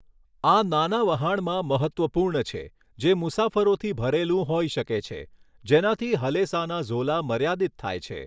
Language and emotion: Gujarati, neutral